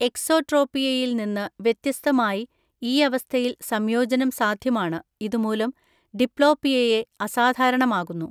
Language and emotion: Malayalam, neutral